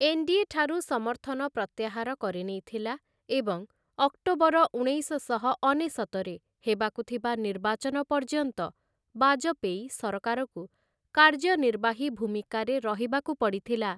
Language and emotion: Odia, neutral